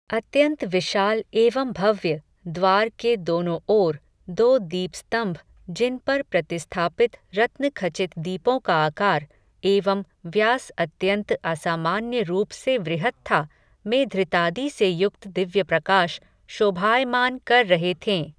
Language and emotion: Hindi, neutral